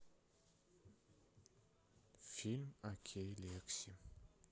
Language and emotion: Russian, sad